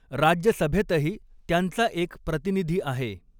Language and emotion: Marathi, neutral